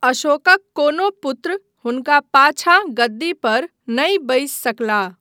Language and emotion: Maithili, neutral